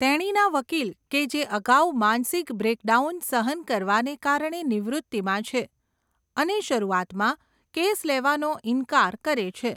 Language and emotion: Gujarati, neutral